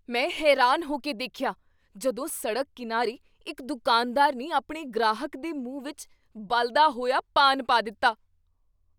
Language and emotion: Punjabi, surprised